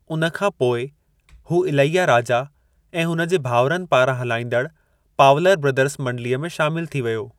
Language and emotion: Sindhi, neutral